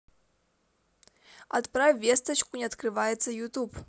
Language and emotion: Russian, positive